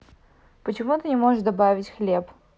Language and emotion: Russian, neutral